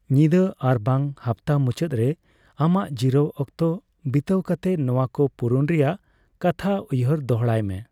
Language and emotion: Santali, neutral